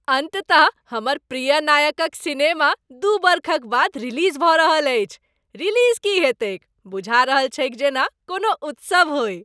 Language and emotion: Maithili, happy